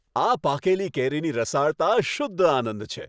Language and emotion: Gujarati, happy